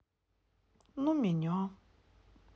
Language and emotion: Russian, sad